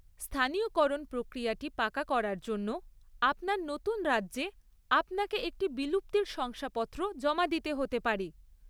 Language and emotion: Bengali, neutral